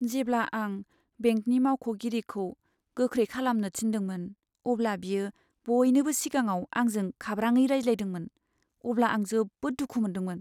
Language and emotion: Bodo, sad